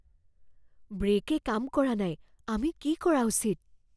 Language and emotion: Assamese, fearful